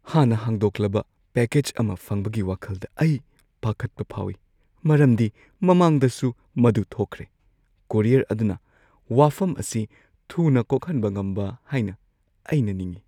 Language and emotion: Manipuri, fearful